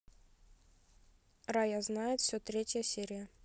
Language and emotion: Russian, neutral